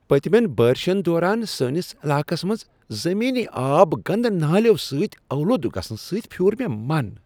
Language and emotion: Kashmiri, disgusted